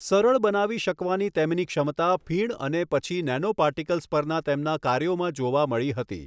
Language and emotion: Gujarati, neutral